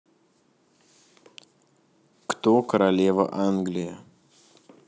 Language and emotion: Russian, neutral